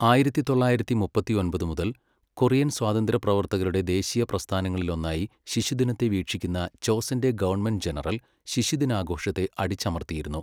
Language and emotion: Malayalam, neutral